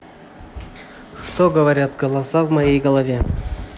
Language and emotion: Russian, neutral